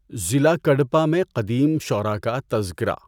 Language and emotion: Urdu, neutral